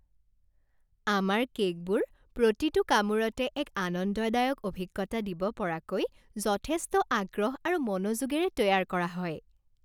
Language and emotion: Assamese, happy